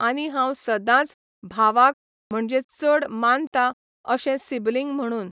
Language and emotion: Goan Konkani, neutral